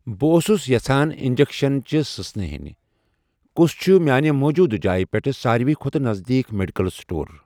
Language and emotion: Kashmiri, neutral